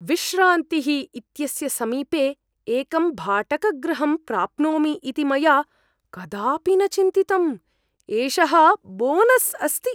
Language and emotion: Sanskrit, surprised